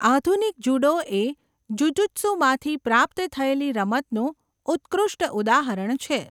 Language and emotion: Gujarati, neutral